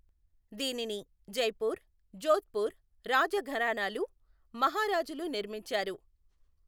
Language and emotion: Telugu, neutral